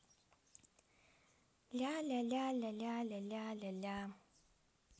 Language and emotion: Russian, positive